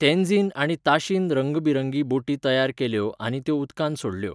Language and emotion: Goan Konkani, neutral